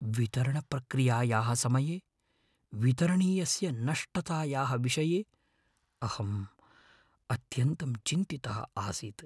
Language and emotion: Sanskrit, fearful